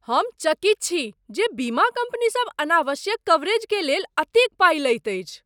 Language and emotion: Maithili, surprised